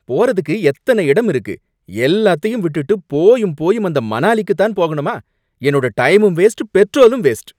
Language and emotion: Tamil, angry